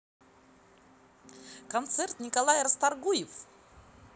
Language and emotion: Russian, positive